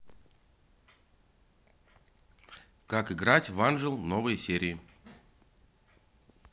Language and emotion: Russian, positive